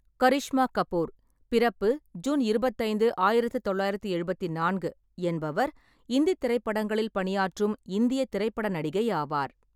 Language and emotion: Tamil, neutral